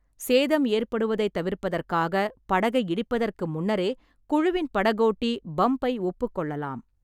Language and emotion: Tamil, neutral